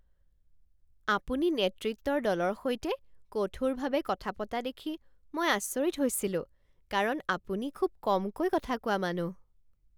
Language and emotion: Assamese, surprised